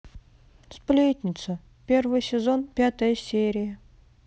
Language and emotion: Russian, sad